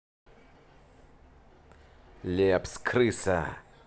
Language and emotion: Russian, angry